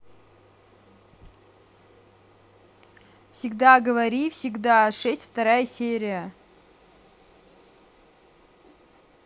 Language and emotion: Russian, angry